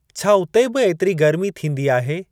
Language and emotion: Sindhi, neutral